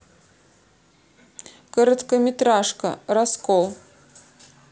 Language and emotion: Russian, neutral